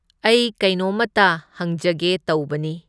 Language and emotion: Manipuri, neutral